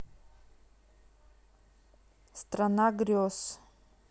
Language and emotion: Russian, neutral